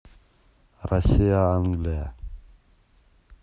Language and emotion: Russian, neutral